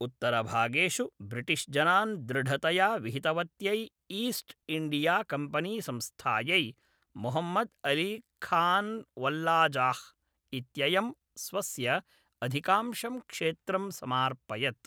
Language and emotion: Sanskrit, neutral